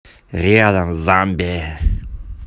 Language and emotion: Russian, neutral